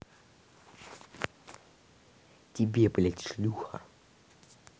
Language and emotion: Russian, angry